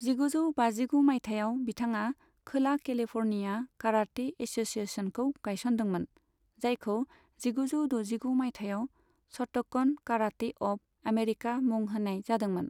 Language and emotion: Bodo, neutral